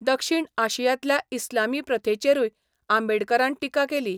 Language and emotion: Goan Konkani, neutral